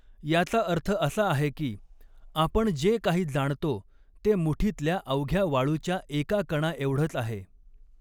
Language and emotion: Marathi, neutral